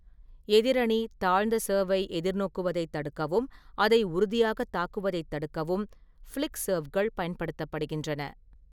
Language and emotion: Tamil, neutral